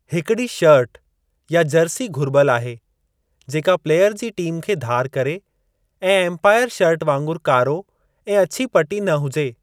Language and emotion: Sindhi, neutral